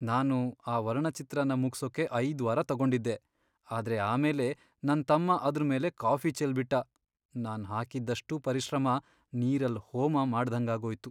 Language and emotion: Kannada, sad